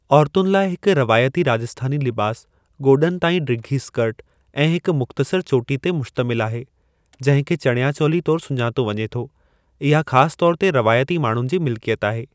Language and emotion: Sindhi, neutral